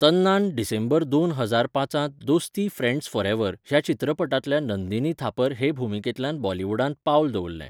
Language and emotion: Goan Konkani, neutral